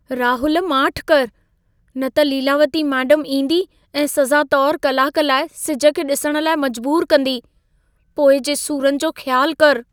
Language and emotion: Sindhi, fearful